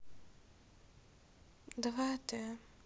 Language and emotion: Russian, sad